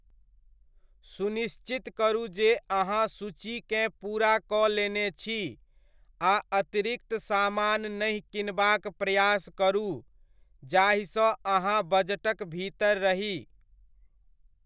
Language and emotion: Maithili, neutral